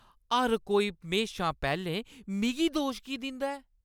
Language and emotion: Dogri, angry